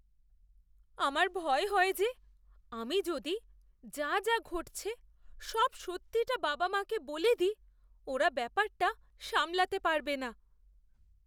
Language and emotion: Bengali, fearful